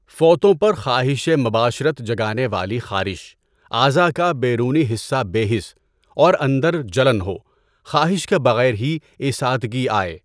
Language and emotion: Urdu, neutral